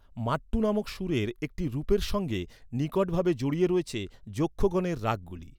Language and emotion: Bengali, neutral